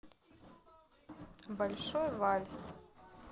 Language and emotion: Russian, neutral